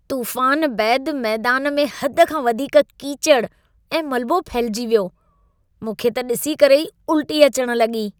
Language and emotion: Sindhi, disgusted